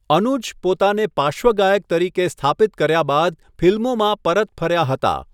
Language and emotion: Gujarati, neutral